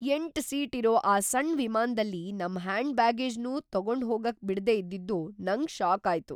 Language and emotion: Kannada, surprised